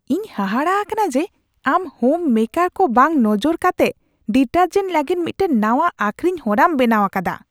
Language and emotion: Santali, disgusted